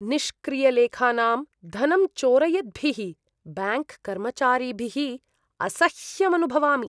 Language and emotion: Sanskrit, disgusted